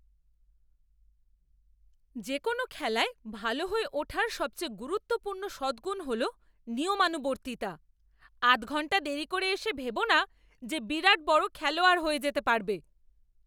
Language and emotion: Bengali, angry